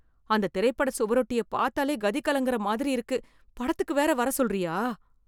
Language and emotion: Tamil, fearful